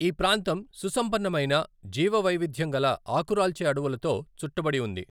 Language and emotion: Telugu, neutral